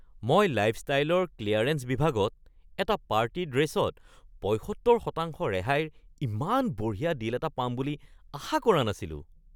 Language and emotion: Assamese, surprised